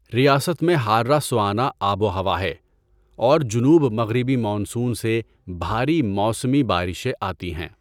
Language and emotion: Urdu, neutral